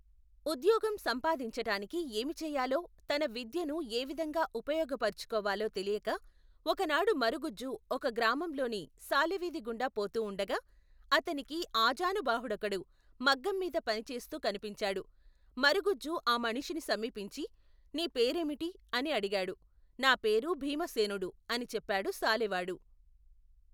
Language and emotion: Telugu, neutral